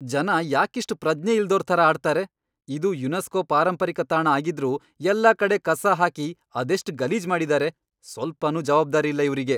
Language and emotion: Kannada, angry